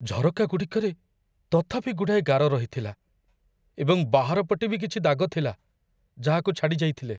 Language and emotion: Odia, fearful